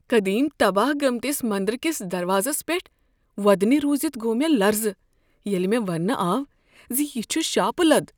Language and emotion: Kashmiri, fearful